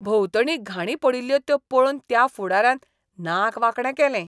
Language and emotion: Goan Konkani, disgusted